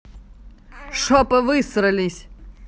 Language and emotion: Russian, angry